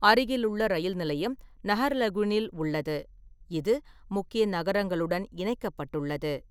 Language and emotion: Tamil, neutral